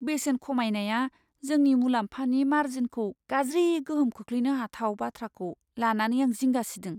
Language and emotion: Bodo, fearful